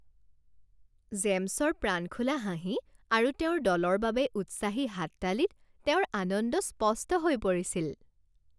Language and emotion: Assamese, happy